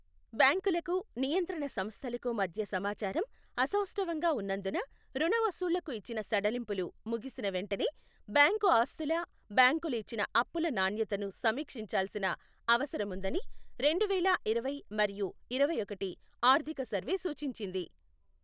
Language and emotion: Telugu, neutral